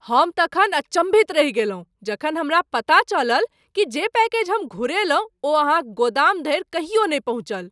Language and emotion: Maithili, surprised